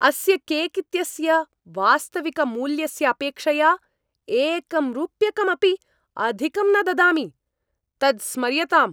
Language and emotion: Sanskrit, angry